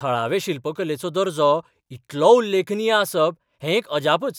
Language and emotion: Goan Konkani, surprised